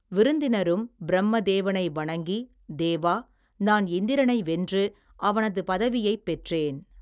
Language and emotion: Tamil, neutral